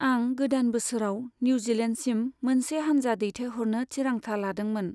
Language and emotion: Bodo, neutral